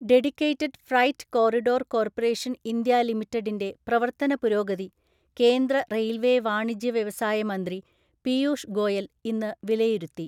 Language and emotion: Malayalam, neutral